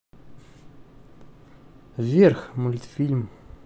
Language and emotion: Russian, neutral